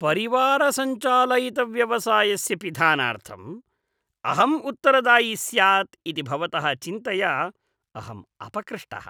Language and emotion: Sanskrit, disgusted